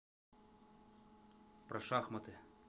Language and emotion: Russian, neutral